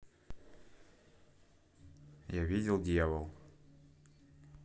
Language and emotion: Russian, neutral